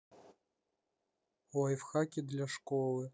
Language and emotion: Russian, neutral